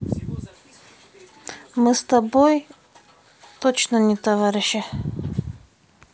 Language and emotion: Russian, neutral